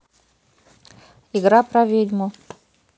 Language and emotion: Russian, neutral